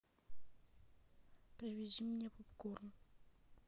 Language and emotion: Russian, neutral